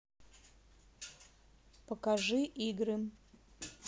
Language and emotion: Russian, neutral